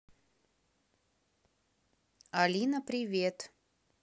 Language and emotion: Russian, neutral